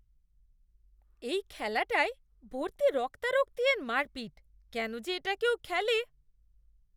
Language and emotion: Bengali, disgusted